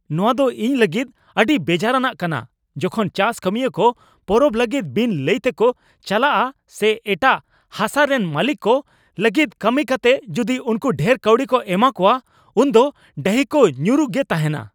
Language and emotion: Santali, angry